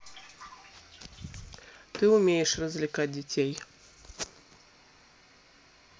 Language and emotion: Russian, neutral